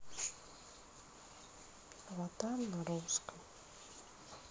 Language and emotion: Russian, sad